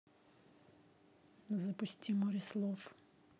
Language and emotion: Russian, neutral